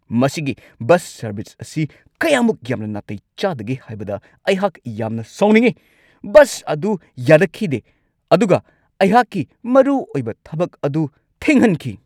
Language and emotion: Manipuri, angry